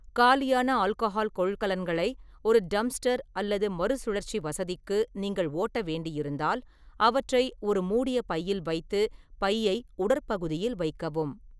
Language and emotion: Tamil, neutral